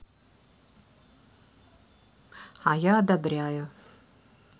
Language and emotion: Russian, neutral